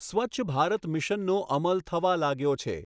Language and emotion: Gujarati, neutral